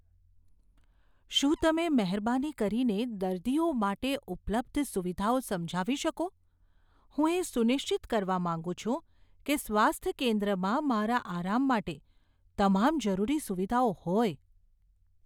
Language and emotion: Gujarati, fearful